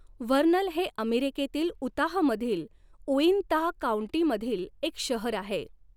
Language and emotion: Marathi, neutral